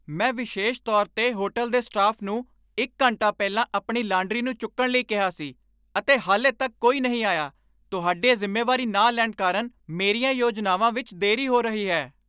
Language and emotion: Punjabi, angry